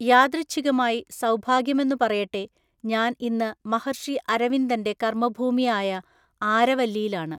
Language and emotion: Malayalam, neutral